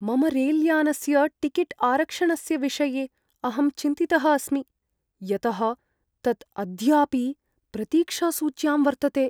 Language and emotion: Sanskrit, fearful